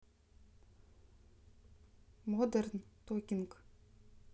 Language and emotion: Russian, neutral